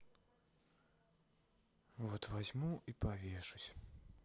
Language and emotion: Russian, sad